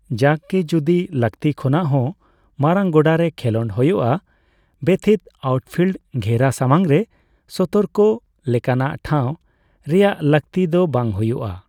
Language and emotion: Santali, neutral